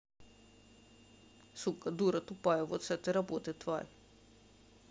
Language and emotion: Russian, angry